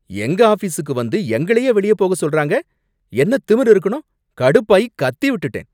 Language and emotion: Tamil, angry